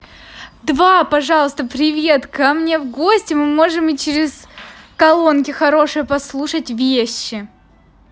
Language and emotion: Russian, positive